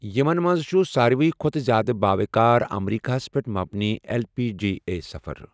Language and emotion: Kashmiri, neutral